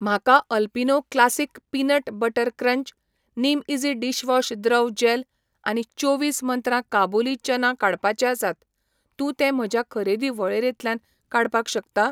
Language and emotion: Goan Konkani, neutral